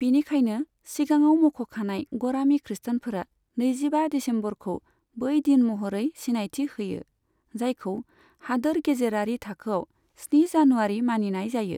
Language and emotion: Bodo, neutral